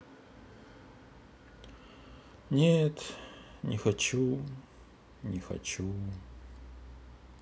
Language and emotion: Russian, sad